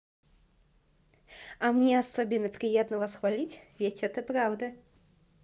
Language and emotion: Russian, positive